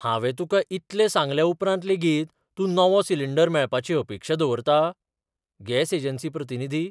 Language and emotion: Goan Konkani, surprised